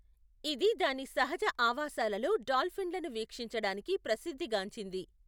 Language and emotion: Telugu, neutral